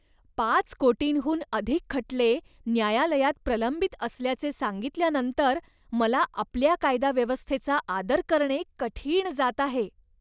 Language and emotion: Marathi, disgusted